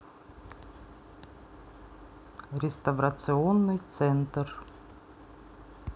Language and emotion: Russian, neutral